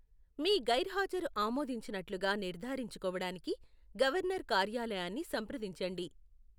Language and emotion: Telugu, neutral